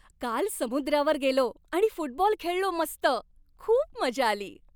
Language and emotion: Marathi, happy